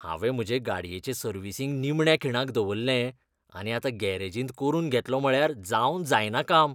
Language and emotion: Goan Konkani, disgusted